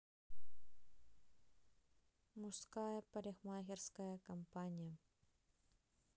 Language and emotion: Russian, neutral